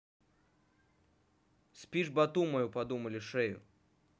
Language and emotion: Russian, neutral